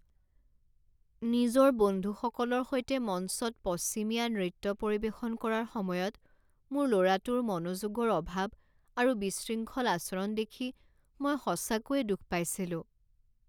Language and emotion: Assamese, sad